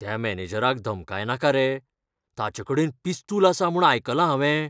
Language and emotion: Goan Konkani, fearful